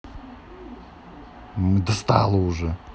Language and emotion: Russian, angry